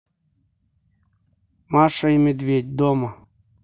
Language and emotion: Russian, neutral